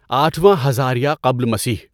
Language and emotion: Urdu, neutral